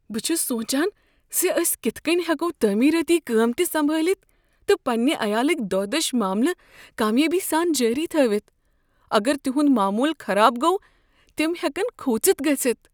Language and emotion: Kashmiri, fearful